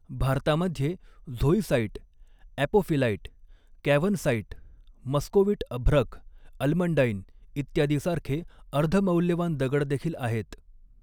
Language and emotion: Marathi, neutral